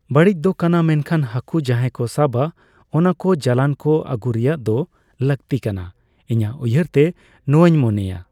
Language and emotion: Santali, neutral